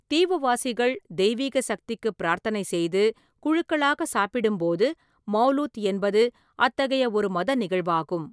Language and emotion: Tamil, neutral